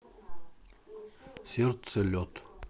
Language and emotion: Russian, neutral